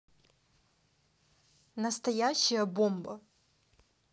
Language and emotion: Russian, neutral